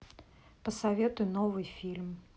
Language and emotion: Russian, neutral